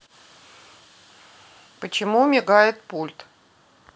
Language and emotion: Russian, neutral